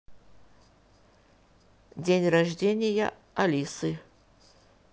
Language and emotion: Russian, neutral